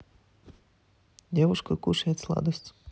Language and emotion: Russian, neutral